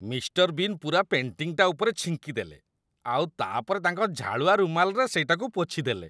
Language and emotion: Odia, disgusted